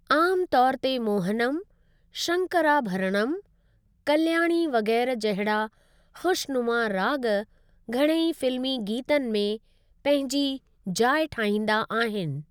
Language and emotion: Sindhi, neutral